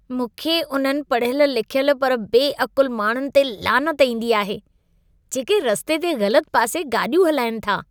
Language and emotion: Sindhi, disgusted